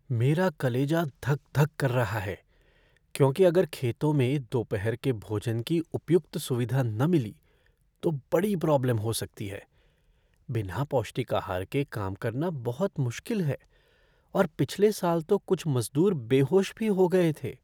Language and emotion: Hindi, fearful